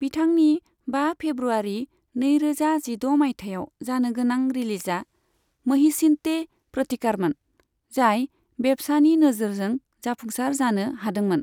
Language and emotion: Bodo, neutral